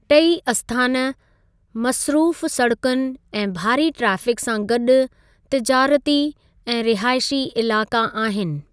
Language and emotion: Sindhi, neutral